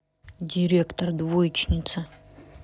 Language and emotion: Russian, neutral